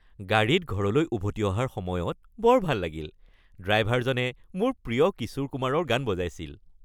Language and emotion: Assamese, happy